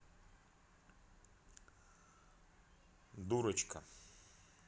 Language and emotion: Russian, neutral